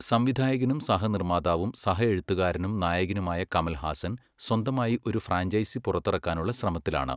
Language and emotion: Malayalam, neutral